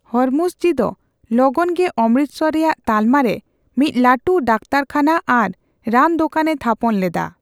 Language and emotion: Santali, neutral